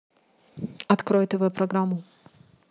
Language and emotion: Russian, neutral